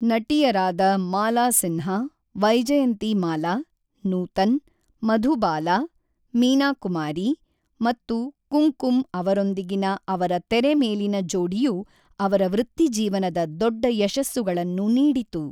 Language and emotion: Kannada, neutral